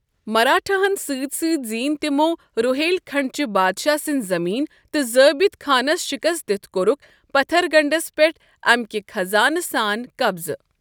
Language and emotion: Kashmiri, neutral